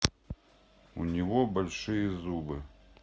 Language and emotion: Russian, neutral